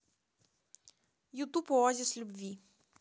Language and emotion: Russian, neutral